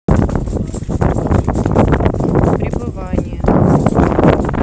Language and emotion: Russian, neutral